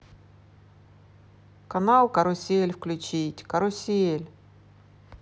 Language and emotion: Russian, positive